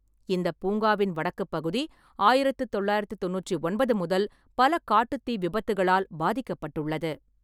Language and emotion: Tamil, neutral